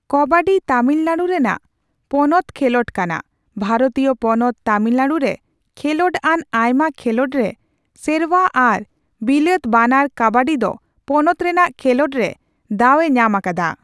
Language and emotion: Santali, neutral